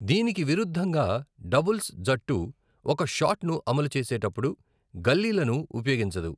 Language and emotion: Telugu, neutral